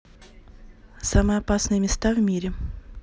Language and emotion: Russian, neutral